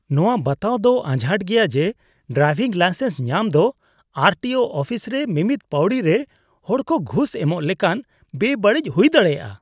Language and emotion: Santali, disgusted